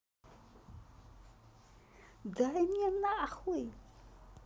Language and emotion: Russian, angry